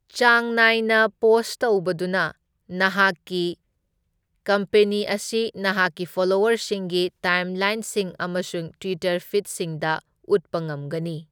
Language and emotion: Manipuri, neutral